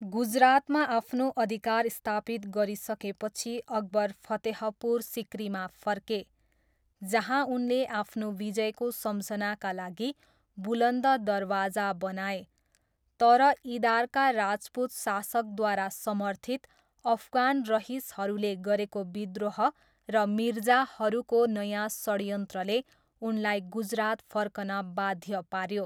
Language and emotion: Nepali, neutral